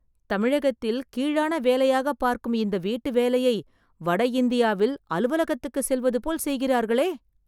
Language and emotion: Tamil, surprised